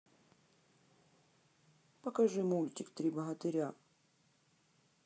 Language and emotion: Russian, neutral